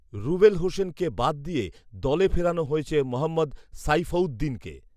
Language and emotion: Bengali, neutral